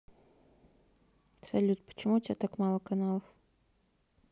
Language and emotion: Russian, neutral